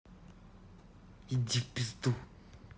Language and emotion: Russian, angry